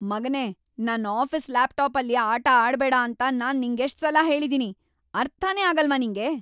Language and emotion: Kannada, angry